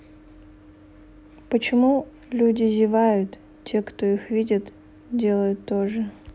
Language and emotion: Russian, neutral